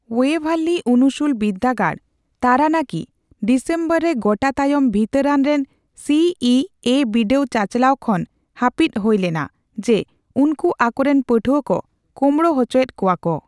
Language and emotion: Santali, neutral